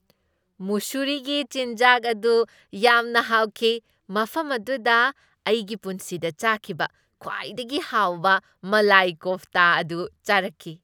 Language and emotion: Manipuri, happy